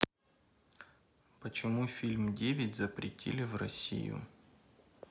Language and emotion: Russian, neutral